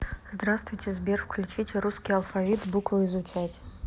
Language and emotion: Russian, neutral